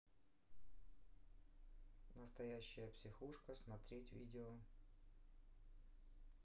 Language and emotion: Russian, neutral